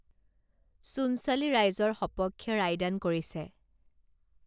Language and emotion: Assamese, neutral